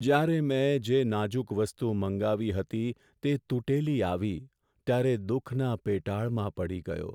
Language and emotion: Gujarati, sad